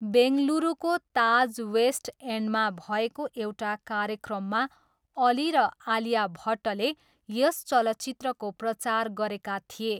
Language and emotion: Nepali, neutral